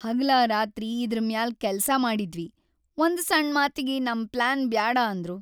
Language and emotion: Kannada, sad